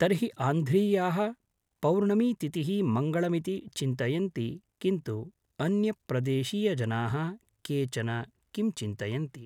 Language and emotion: Sanskrit, neutral